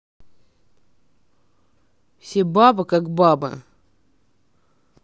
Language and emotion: Russian, neutral